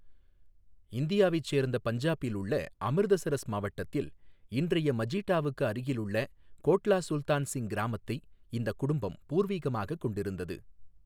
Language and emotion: Tamil, neutral